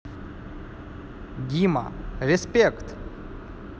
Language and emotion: Russian, positive